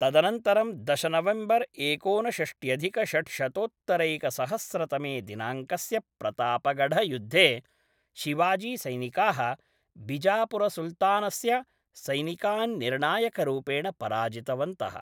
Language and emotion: Sanskrit, neutral